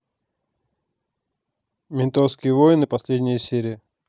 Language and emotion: Russian, neutral